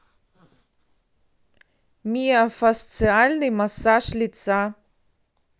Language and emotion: Russian, neutral